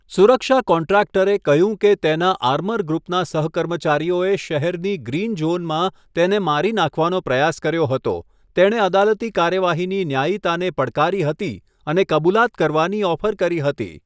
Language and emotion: Gujarati, neutral